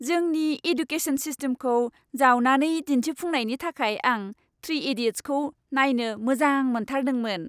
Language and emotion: Bodo, happy